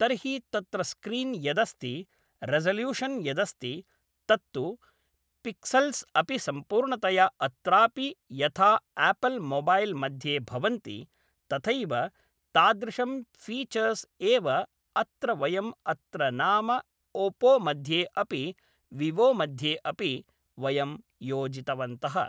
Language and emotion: Sanskrit, neutral